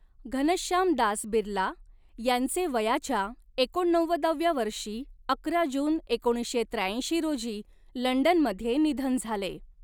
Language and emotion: Marathi, neutral